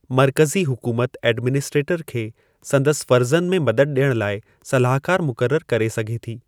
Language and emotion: Sindhi, neutral